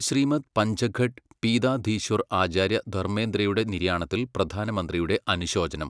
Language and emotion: Malayalam, neutral